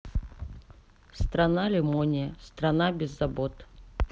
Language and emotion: Russian, neutral